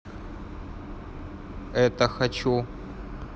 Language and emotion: Russian, neutral